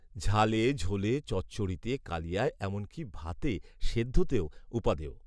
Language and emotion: Bengali, neutral